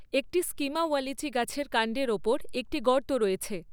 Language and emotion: Bengali, neutral